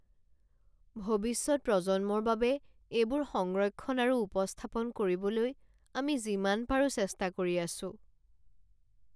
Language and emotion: Assamese, sad